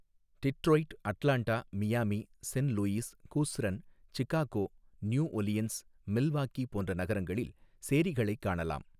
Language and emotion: Tamil, neutral